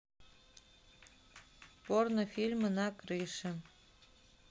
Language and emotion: Russian, neutral